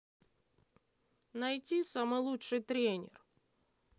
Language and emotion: Russian, neutral